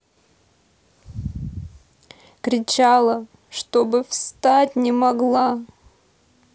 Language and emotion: Russian, sad